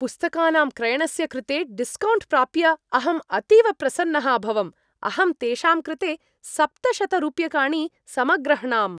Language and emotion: Sanskrit, happy